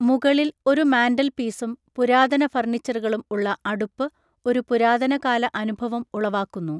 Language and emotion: Malayalam, neutral